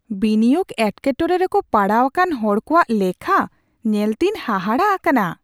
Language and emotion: Santali, surprised